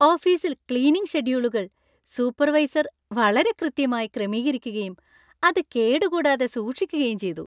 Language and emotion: Malayalam, happy